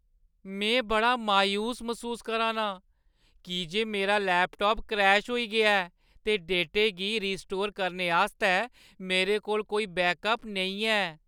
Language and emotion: Dogri, sad